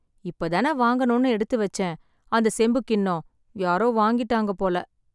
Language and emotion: Tamil, sad